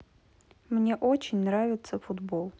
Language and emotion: Russian, neutral